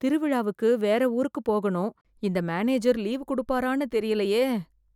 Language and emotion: Tamil, fearful